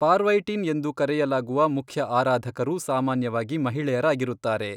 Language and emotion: Kannada, neutral